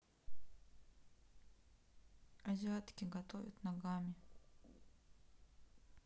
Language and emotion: Russian, sad